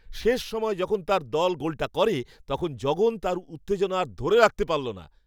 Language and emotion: Bengali, happy